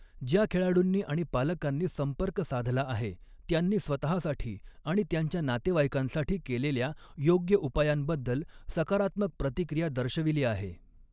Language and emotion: Marathi, neutral